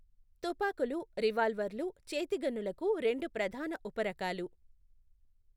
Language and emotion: Telugu, neutral